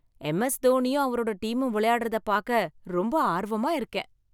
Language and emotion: Tamil, happy